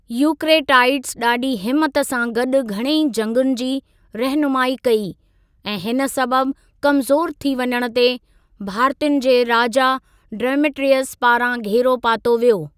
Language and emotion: Sindhi, neutral